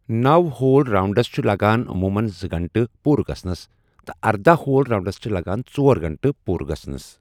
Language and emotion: Kashmiri, neutral